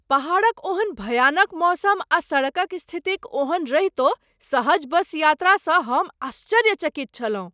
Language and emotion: Maithili, surprised